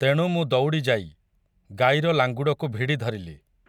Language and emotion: Odia, neutral